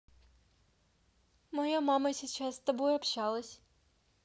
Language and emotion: Russian, neutral